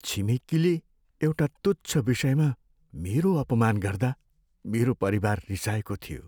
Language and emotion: Nepali, sad